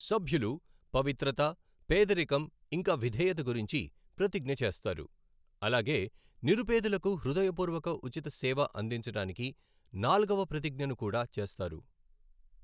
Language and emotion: Telugu, neutral